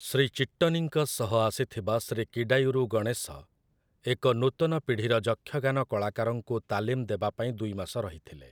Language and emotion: Odia, neutral